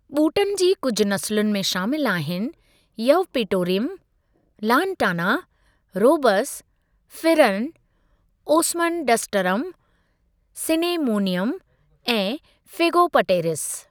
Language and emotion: Sindhi, neutral